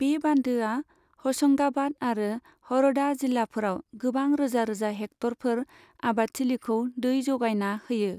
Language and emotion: Bodo, neutral